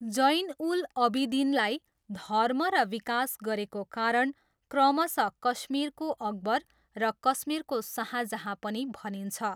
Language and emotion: Nepali, neutral